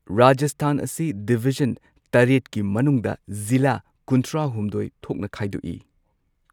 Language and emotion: Manipuri, neutral